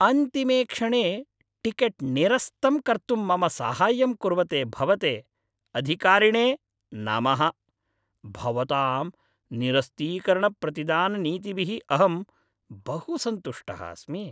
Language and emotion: Sanskrit, happy